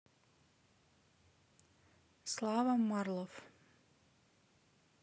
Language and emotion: Russian, neutral